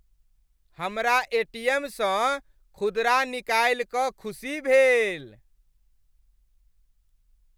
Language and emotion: Maithili, happy